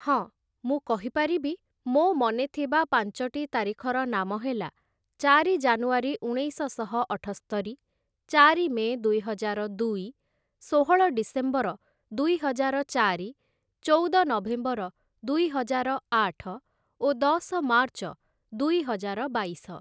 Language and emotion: Odia, neutral